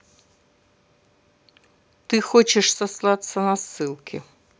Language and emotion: Russian, neutral